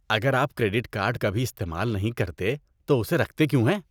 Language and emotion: Urdu, disgusted